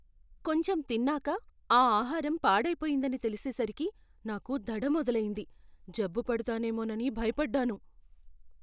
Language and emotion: Telugu, fearful